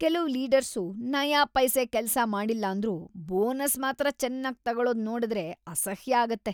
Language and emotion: Kannada, disgusted